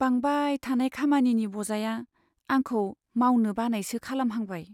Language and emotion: Bodo, sad